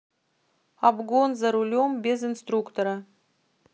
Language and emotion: Russian, neutral